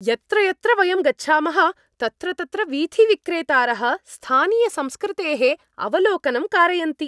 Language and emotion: Sanskrit, happy